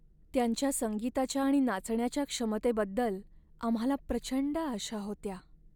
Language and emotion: Marathi, sad